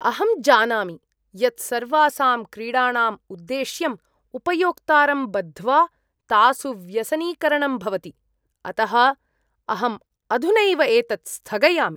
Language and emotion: Sanskrit, disgusted